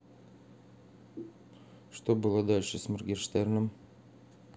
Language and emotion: Russian, neutral